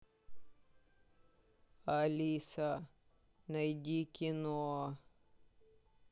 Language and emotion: Russian, sad